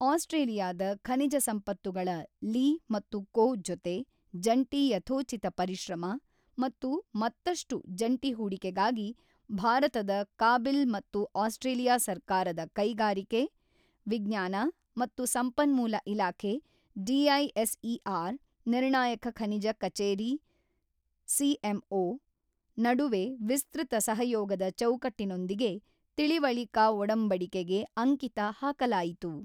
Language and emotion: Kannada, neutral